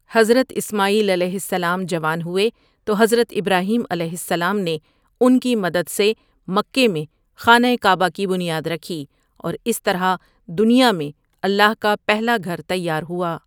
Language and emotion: Urdu, neutral